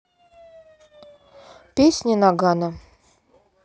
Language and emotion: Russian, neutral